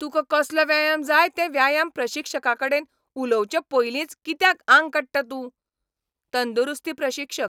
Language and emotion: Goan Konkani, angry